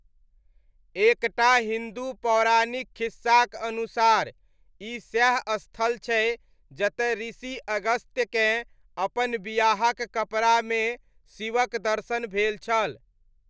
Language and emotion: Maithili, neutral